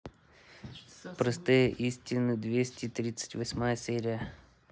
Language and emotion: Russian, neutral